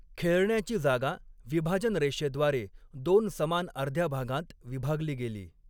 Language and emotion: Marathi, neutral